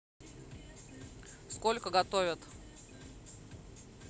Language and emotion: Russian, neutral